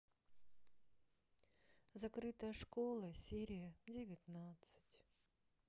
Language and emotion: Russian, sad